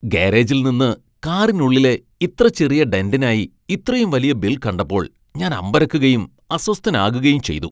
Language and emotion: Malayalam, disgusted